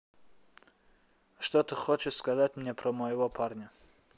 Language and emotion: Russian, neutral